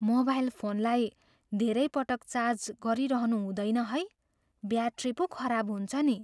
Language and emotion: Nepali, fearful